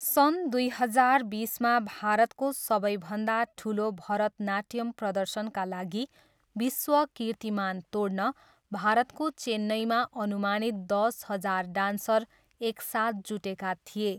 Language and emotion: Nepali, neutral